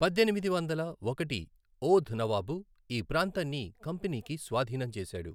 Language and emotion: Telugu, neutral